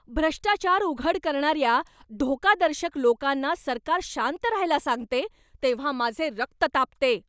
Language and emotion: Marathi, angry